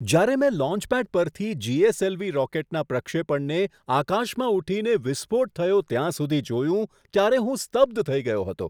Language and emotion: Gujarati, surprised